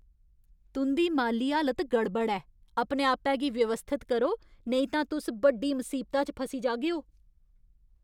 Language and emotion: Dogri, angry